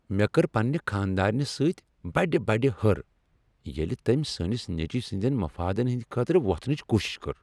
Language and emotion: Kashmiri, angry